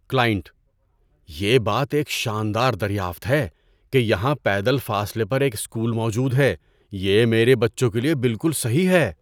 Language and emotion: Urdu, surprised